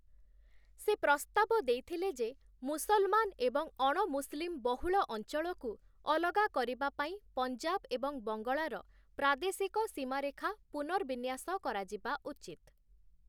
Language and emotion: Odia, neutral